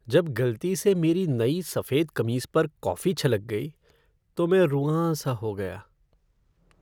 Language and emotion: Hindi, sad